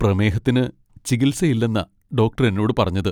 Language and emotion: Malayalam, sad